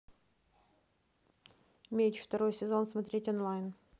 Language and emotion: Russian, neutral